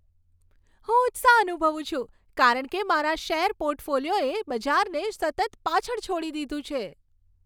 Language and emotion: Gujarati, happy